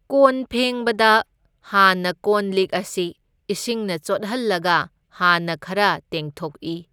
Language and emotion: Manipuri, neutral